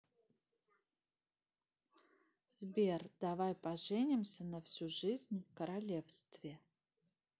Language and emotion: Russian, neutral